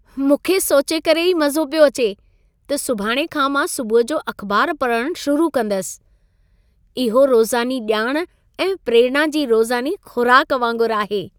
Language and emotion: Sindhi, happy